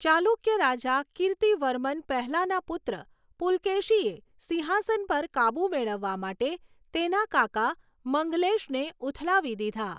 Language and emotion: Gujarati, neutral